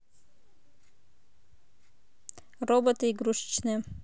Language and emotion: Russian, neutral